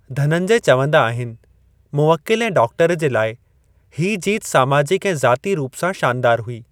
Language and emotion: Sindhi, neutral